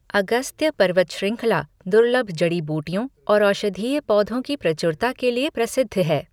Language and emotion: Hindi, neutral